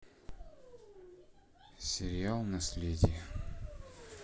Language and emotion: Russian, sad